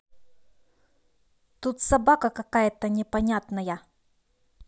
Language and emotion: Russian, angry